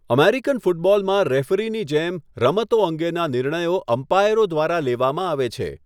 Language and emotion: Gujarati, neutral